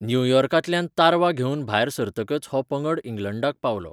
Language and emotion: Goan Konkani, neutral